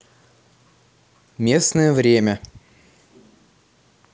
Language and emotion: Russian, neutral